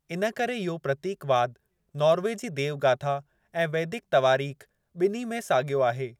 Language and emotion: Sindhi, neutral